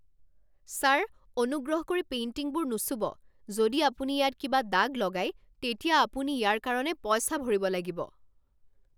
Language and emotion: Assamese, angry